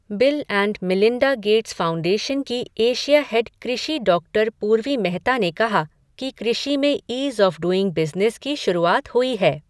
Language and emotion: Hindi, neutral